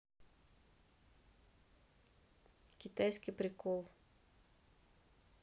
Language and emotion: Russian, neutral